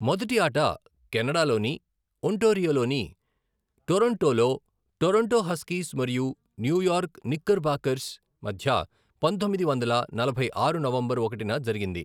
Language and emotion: Telugu, neutral